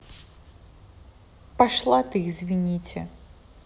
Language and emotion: Russian, angry